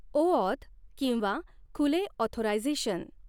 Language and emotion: Marathi, neutral